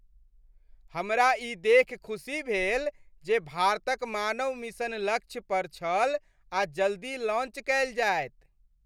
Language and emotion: Maithili, happy